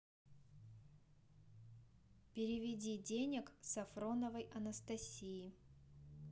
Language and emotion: Russian, neutral